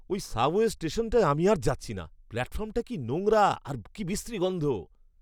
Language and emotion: Bengali, disgusted